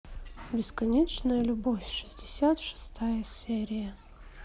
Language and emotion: Russian, neutral